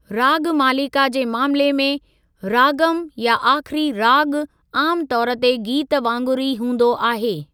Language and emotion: Sindhi, neutral